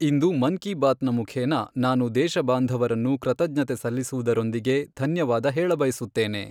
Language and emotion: Kannada, neutral